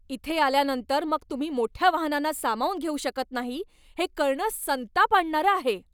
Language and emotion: Marathi, angry